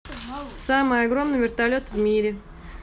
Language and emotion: Russian, neutral